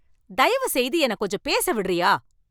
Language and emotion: Tamil, angry